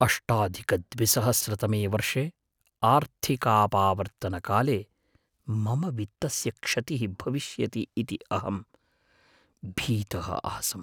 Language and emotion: Sanskrit, fearful